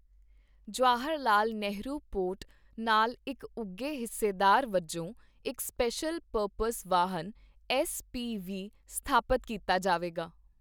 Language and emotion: Punjabi, neutral